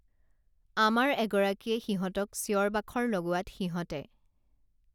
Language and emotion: Assamese, neutral